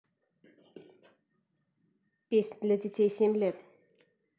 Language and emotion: Russian, neutral